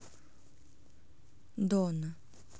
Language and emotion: Russian, neutral